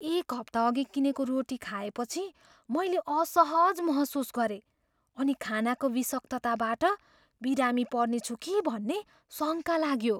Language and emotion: Nepali, fearful